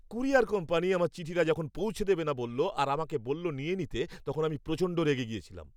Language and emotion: Bengali, angry